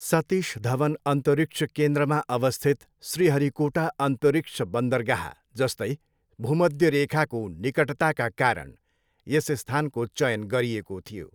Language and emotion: Nepali, neutral